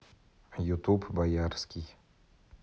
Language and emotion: Russian, neutral